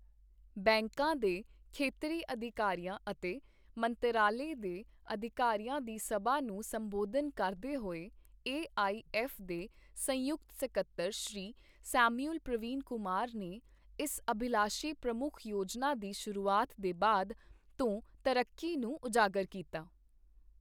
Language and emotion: Punjabi, neutral